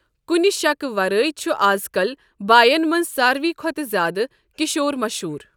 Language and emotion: Kashmiri, neutral